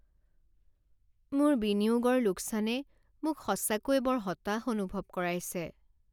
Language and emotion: Assamese, sad